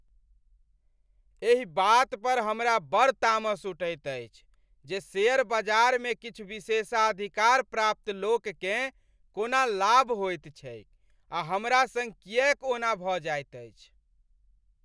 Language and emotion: Maithili, angry